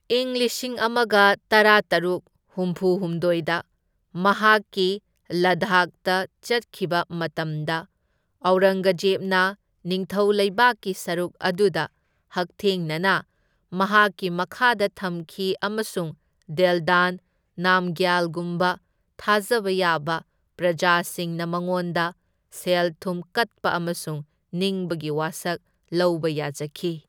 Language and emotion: Manipuri, neutral